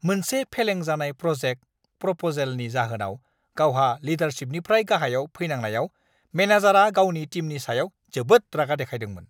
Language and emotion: Bodo, angry